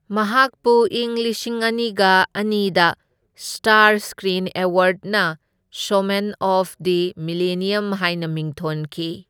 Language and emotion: Manipuri, neutral